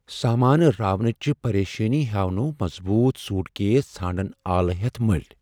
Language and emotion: Kashmiri, fearful